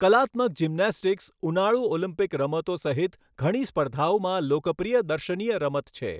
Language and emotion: Gujarati, neutral